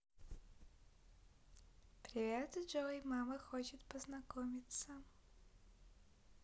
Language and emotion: Russian, positive